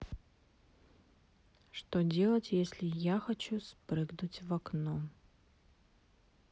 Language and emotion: Russian, neutral